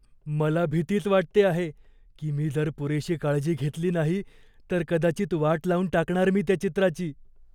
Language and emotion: Marathi, fearful